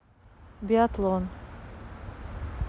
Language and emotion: Russian, neutral